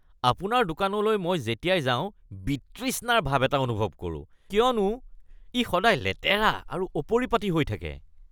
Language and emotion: Assamese, disgusted